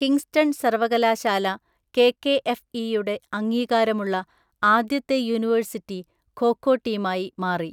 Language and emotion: Malayalam, neutral